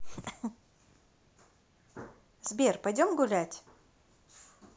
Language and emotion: Russian, positive